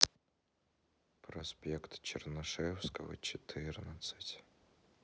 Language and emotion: Russian, sad